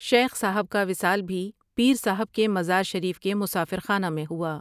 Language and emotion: Urdu, neutral